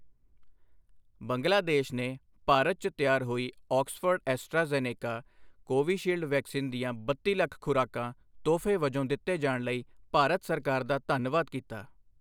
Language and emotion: Punjabi, neutral